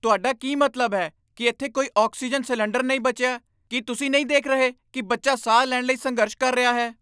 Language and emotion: Punjabi, angry